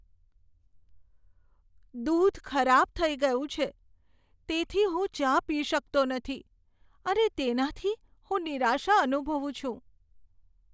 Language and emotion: Gujarati, sad